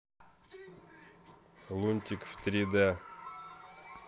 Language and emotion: Russian, neutral